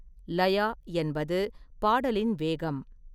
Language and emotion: Tamil, neutral